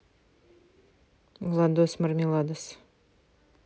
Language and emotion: Russian, neutral